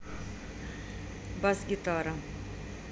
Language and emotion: Russian, neutral